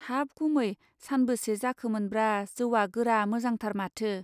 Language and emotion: Bodo, neutral